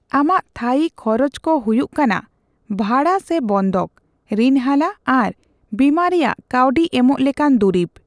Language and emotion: Santali, neutral